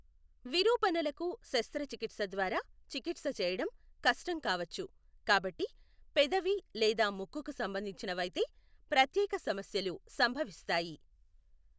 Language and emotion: Telugu, neutral